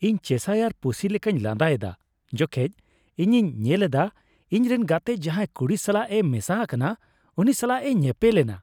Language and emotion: Santali, happy